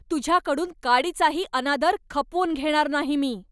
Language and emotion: Marathi, angry